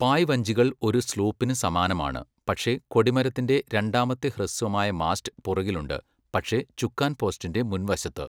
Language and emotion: Malayalam, neutral